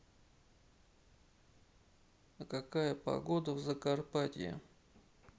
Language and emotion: Russian, neutral